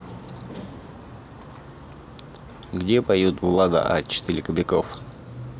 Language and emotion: Russian, neutral